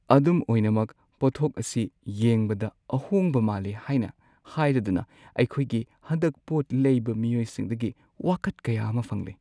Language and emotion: Manipuri, sad